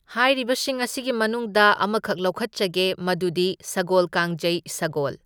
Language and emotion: Manipuri, neutral